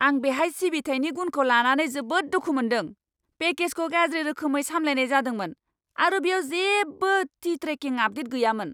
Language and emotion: Bodo, angry